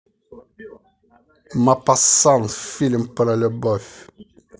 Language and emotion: Russian, positive